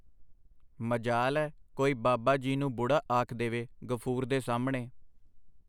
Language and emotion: Punjabi, neutral